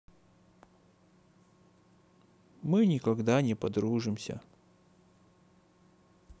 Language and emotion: Russian, sad